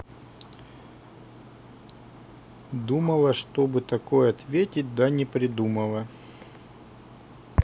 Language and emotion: Russian, neutral